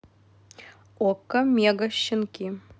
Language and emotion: Russian, neutral